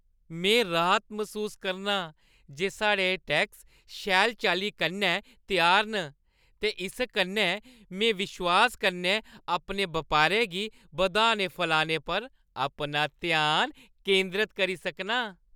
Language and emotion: Dogri, happy